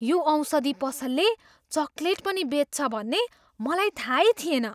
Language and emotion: Nepali, surprised